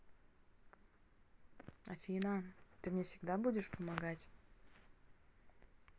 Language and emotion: Russian, neutral